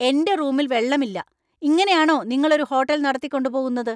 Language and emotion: Malayalam, angry